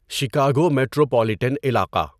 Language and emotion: Urdu, neutral